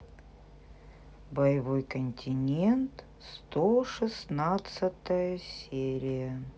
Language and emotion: Russian, neutral